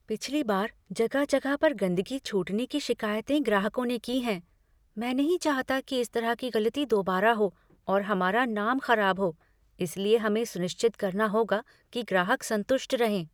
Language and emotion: Hindi, fearful